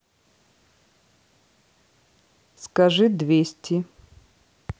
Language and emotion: Russian, neutral